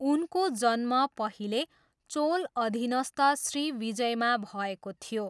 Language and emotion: Nepali, neutral